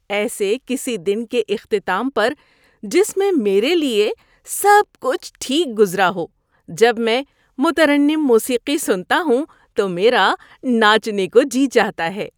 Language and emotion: Urdu, happy